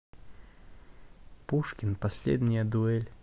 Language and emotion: Russian, neutral